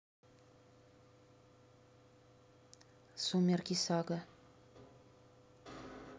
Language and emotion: Russian, neutral